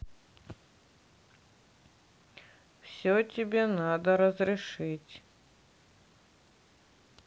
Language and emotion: Russian, neutral